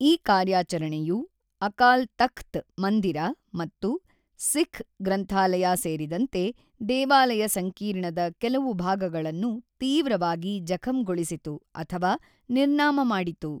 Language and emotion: Kannada, neutral